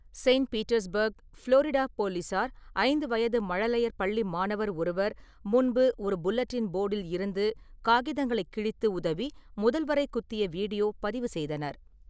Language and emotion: Tamil, neutral